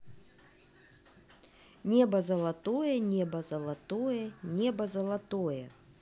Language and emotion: Russian, neutral